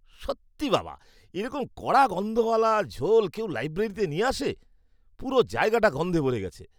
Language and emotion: Bengali, disgusted